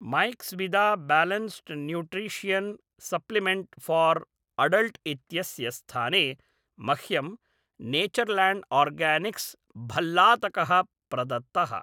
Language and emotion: Sanskrit, neutral